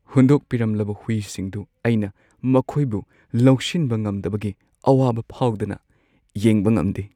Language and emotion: Manipuri, sad